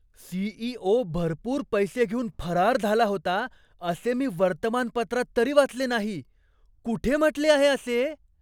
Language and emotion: Marathi, surprised